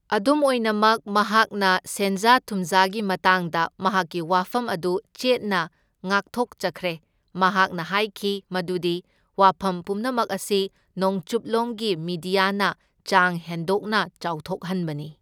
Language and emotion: Manipuri, neutral